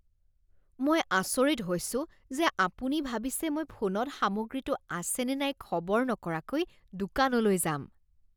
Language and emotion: Assamese, disgusted